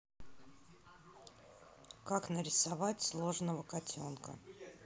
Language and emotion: Russian, neutral